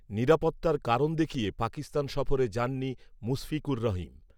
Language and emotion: Bengali, neutral